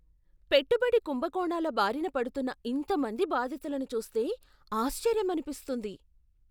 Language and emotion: Telugu, surprised